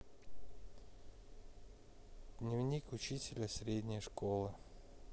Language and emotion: Russian, neutral